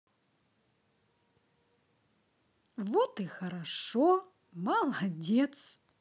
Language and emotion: Russian, positive